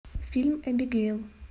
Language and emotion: Russian, neutral